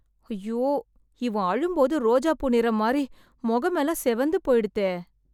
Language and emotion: Tamil, sad